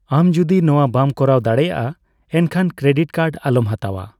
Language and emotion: Santali, neutral